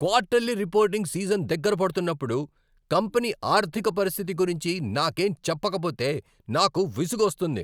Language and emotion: Telugu, angry